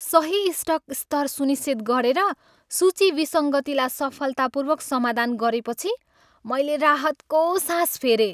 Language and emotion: Nepali, happy